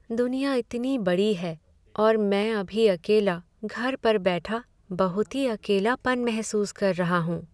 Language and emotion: Hindi, sad